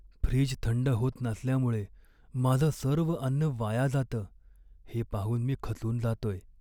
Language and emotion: Marathi, sad